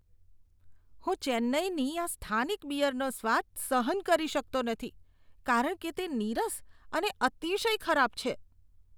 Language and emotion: Gujarati, disgusted